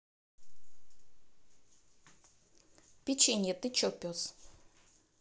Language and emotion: Russian, neutral